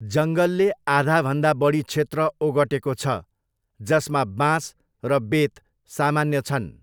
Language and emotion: Nepali, neutral